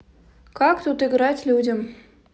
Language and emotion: Russian, neutral